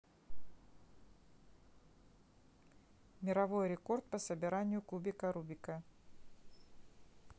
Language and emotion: Russian, neutral